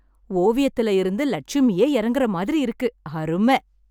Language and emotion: Tamil, happy